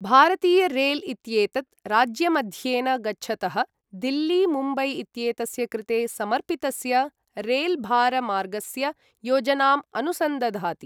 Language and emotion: Sanskrit, neutral